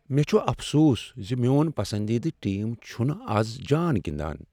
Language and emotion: Kashmiri, sad